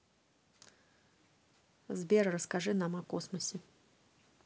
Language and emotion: Russian, neutral